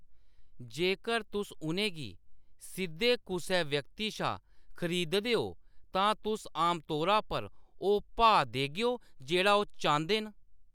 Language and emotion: Dogri, neutral